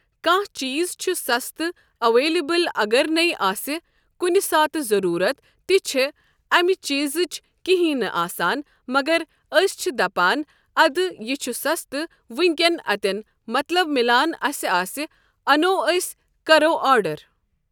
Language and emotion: Kashmiri, neutral